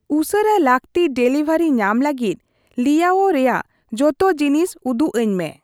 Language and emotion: Santali, neutral